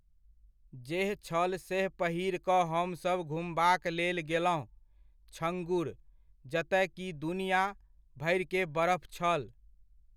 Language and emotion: Maithili, neutral